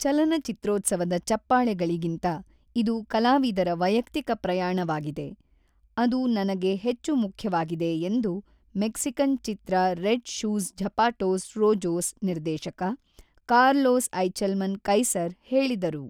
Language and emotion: Kannada, neutral